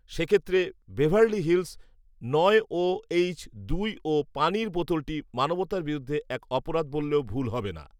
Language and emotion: Bengali, neutral